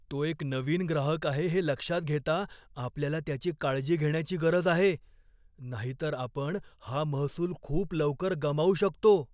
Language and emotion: Marathi, fearful